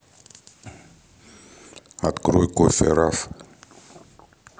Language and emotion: Russian, neutral